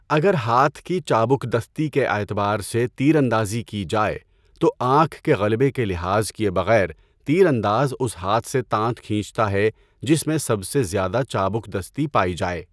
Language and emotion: Urdu, neutral